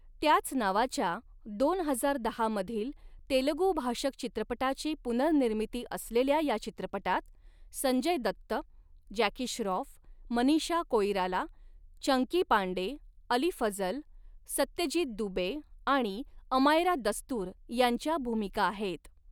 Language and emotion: Marathi, neutral